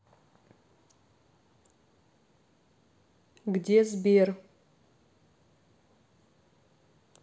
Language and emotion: Russian, neutral